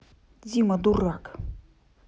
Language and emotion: Russian, angry